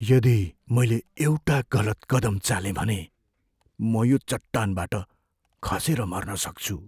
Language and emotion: Nepali, fearful